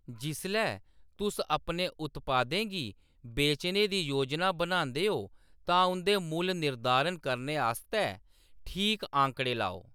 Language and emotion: Dogri, neutral